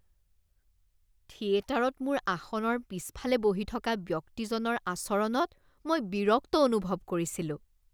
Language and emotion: Assamese, disgusted